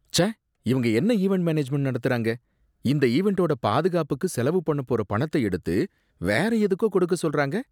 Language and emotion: Tamil, disgusted